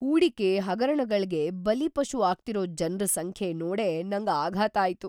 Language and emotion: Kannada, surprised